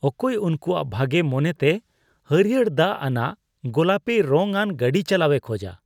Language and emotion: Santali, disgusted